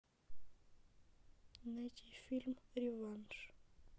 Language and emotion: Russian, sad